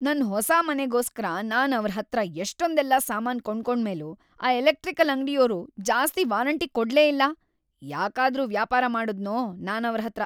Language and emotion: Kannada, angry